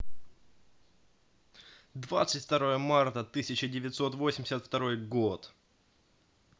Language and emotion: Russian, positive